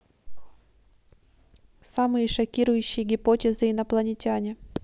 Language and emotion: Russian, neutral